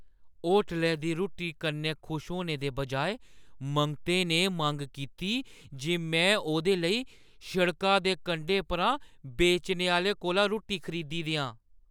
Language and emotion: Dogri, surprised